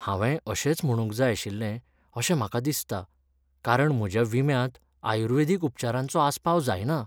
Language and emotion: Goan Konkani, sad